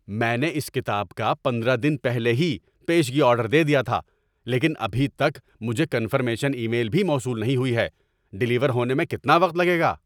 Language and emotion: Urdu, angry